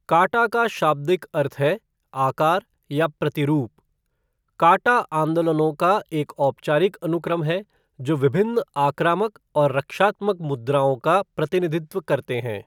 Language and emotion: Hindi, neutral